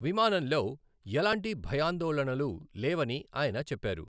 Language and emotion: Telugu, neutral